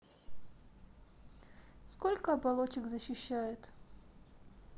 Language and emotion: Russian, neutral